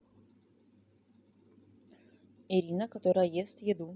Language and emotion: Russian, neutral